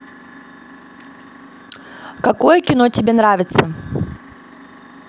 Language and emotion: Russian, neutral